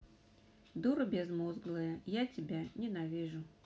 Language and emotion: Russian, neutral